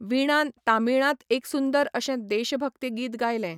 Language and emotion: Goan Konkani, neutral